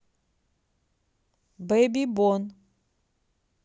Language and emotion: Russian, neutral